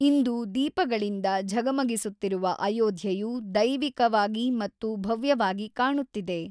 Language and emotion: Kannada, neutral